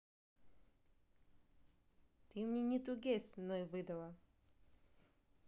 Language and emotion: Russian, neutral